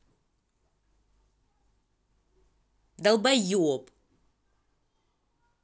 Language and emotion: Russian, angry